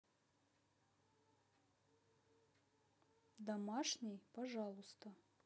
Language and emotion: Russian, neutral